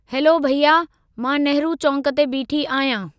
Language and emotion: Sindhi, neutral